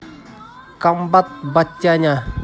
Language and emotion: Russian, positive